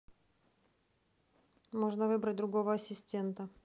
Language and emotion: Russian, neutral